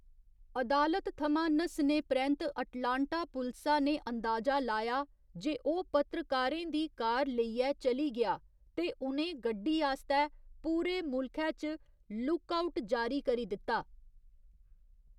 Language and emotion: Dogri, neutral